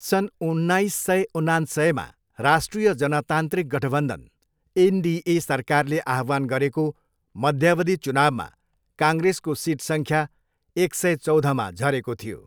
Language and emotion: Nepali, neutral